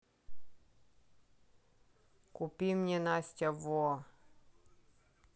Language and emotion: Russian, neutral